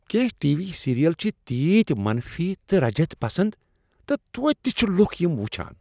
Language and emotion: Kashmiri, disgusted